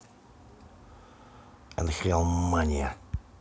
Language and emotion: Russian, neutral